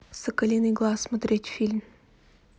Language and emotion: Russian, neutral